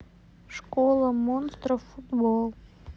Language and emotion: Russian, sad